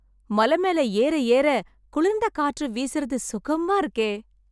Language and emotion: Tamil, happy